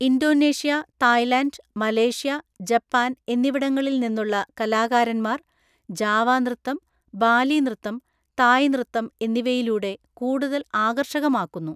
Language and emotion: Malayalam, neutral